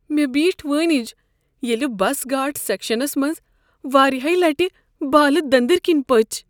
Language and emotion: Kashmiri, fearful